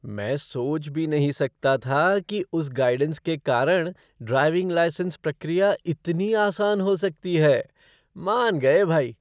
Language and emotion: Hindi, surprised